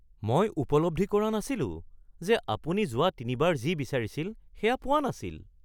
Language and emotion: Assamese, surprised